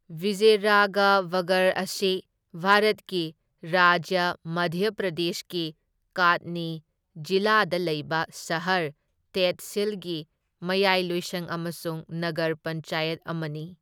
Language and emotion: Manipuri, neutral